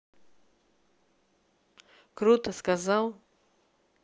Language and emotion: Russian, neutral